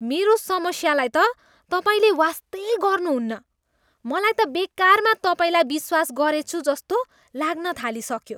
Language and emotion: Nepali, disgusted